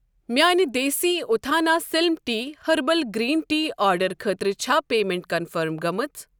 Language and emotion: Kashmiri, neutral